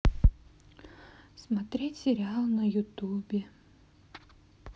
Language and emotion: Russian, sad